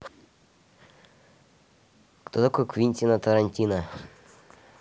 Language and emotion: Russian, neutral